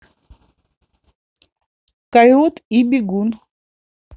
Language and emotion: Russian, neutral